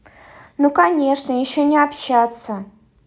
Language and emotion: Russian, angry